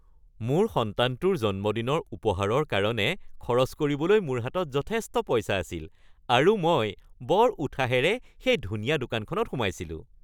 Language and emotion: Assamese, happy